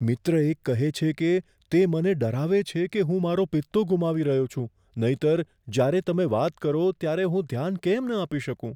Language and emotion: Gujarati, fearful